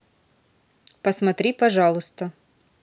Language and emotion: Russian, neutral